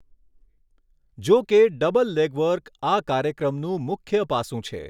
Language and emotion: Gujarati, neutral